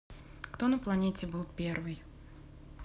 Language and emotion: Russian, neutral